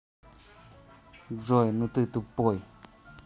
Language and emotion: Russian, angry